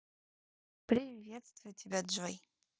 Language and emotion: Russian, positive